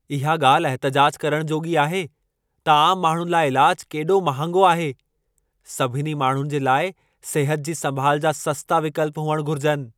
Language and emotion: Sindhi, angry